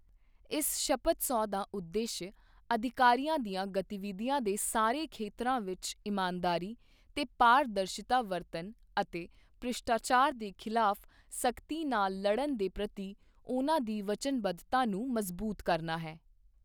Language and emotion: Punjabi, neutral